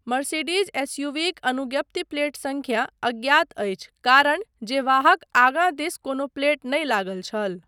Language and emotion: Maithili, neutral